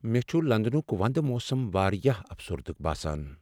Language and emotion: Kashmiri, sad